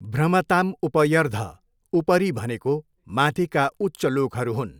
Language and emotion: Nepali, neutral